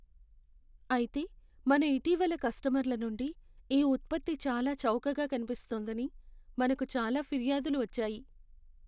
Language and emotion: Telugu, sad